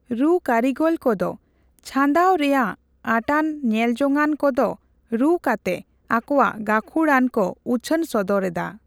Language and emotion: Santali, neutral